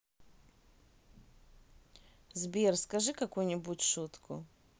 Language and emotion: Russian, neutral